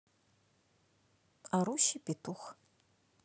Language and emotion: Russian, neutral